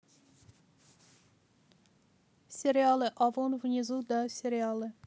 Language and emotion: Russian, neutral